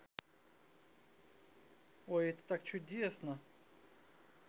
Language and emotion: Russian, positive